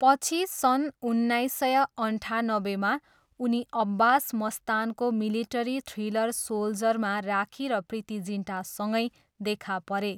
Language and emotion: Nepali, neutral